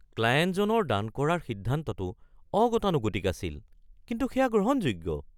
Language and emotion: Assamese, surprised